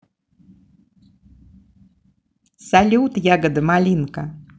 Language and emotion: Russian, positive